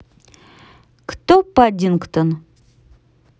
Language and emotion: Russian, neutral